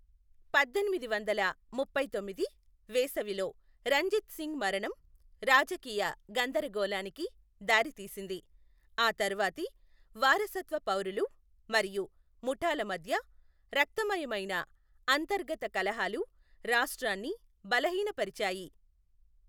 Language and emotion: Telugu, neutral